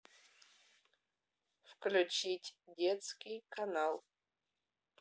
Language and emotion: Russian, neutral